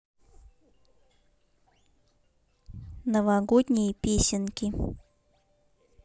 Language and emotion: Russian, neutral